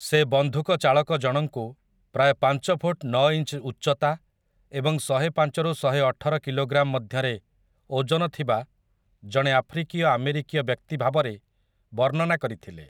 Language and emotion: Odia, neutral